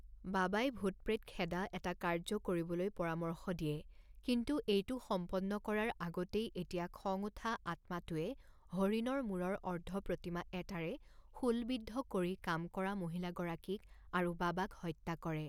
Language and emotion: Assamese, neutral